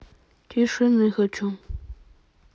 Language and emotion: Russian, neutral